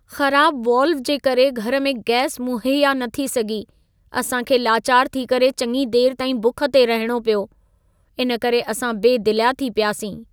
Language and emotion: Sindhi, sad